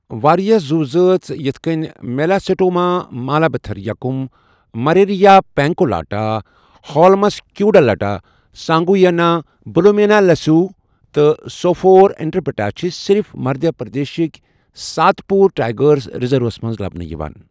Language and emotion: Kashmiri, neutral